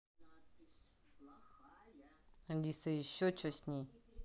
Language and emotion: Russian, neutral